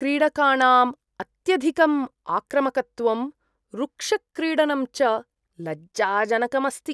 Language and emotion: Sanskrit, disgusted